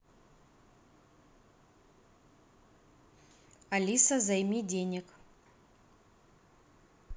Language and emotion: Russian, neutral